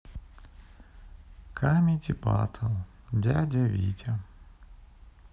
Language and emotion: Russian, sad